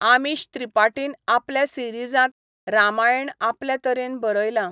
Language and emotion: Goan Konkani, neutral